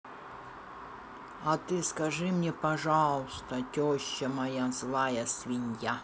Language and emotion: Russian, neutral